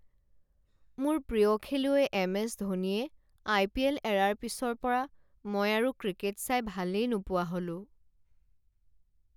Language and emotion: Assamese, sad